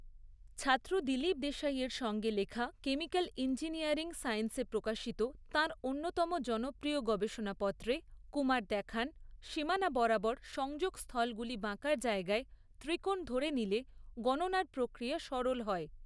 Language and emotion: Bengali, neutral